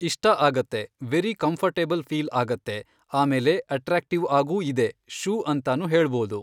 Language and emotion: Kannada, neutral